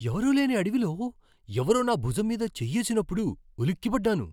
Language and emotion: Telugu, surprised